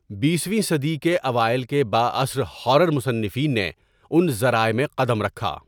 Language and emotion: Urdu, neutral